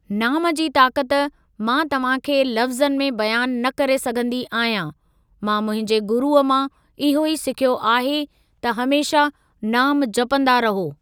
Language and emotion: Sindhi, neutral